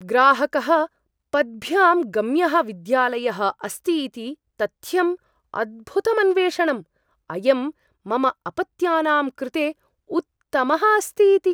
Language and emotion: Sanskrit, surprised